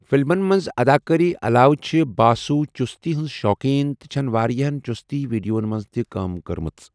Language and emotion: Kashmiri, neutral